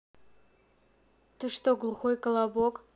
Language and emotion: Russian, neutral